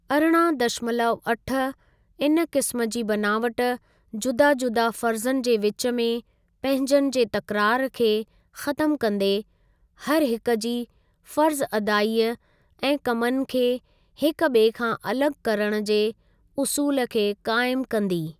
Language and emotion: Sindhi, neutral